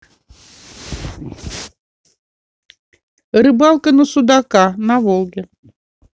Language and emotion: Russian, neutral